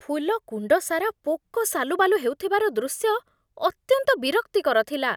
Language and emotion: Odia, disgusted